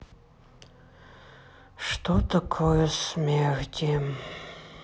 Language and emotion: Russian, sad